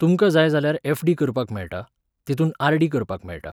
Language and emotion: Goan Konkani, neutral